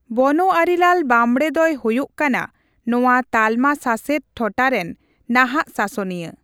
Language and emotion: Santali, neutral